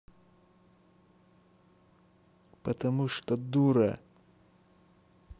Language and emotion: Russian, angry